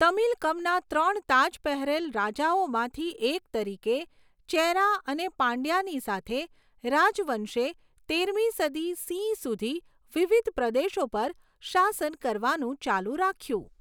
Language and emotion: Gujarati, neutral